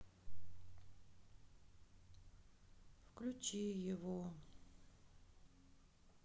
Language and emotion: Russian, sad